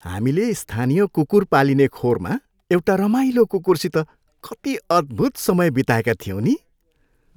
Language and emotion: Nepali, happy